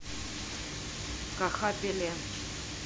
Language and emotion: Russian, neutral